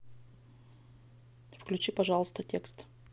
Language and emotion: Russian, neutral